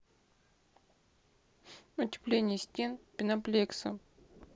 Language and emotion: Russian, sad